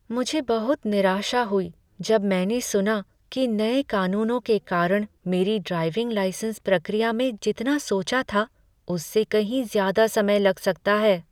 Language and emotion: Hindi, sad